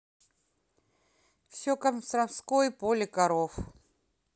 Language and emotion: Russian, neutral